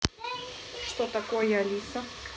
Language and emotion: Russian, neutral